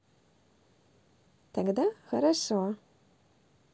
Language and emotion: Russian, positive